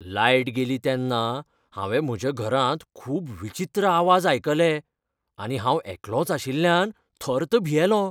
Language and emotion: Goan Konkani, fearful